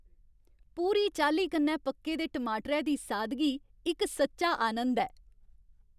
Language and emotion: Dogri, happy